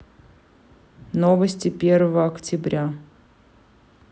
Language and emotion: Russian, neutral